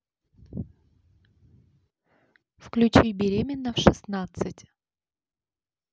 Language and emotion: Russian, neutral